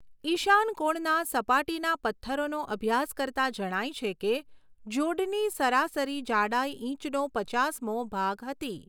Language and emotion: Gujarati, neutral